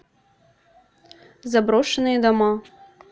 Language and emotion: Russian, neutral